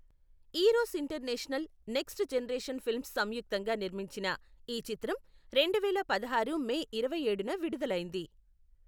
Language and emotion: Telugu, neutral